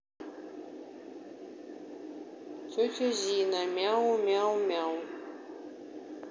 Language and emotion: Russian, neutral